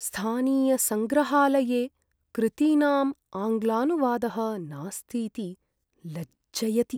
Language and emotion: Sanskrit, sad